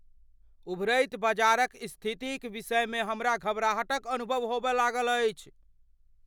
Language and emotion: Maithili, fearful